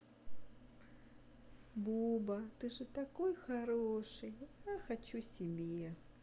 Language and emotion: Russian, positive